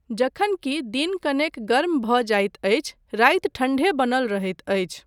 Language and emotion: Maithili, neutral